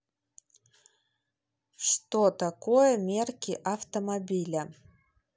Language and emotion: Russian, neutral